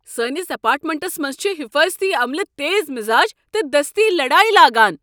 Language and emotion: Kashmiri, angry